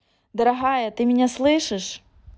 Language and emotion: Russian, neutral